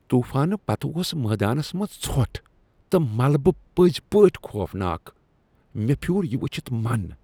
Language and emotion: Kashmiri, disgusted